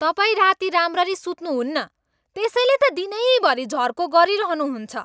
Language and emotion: Nepali, angry